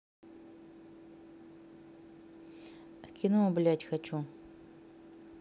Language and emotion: Russian, neutral